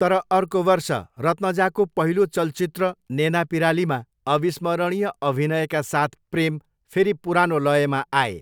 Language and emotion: Nepali, neutral